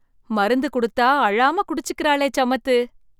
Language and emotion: Tamil, surprised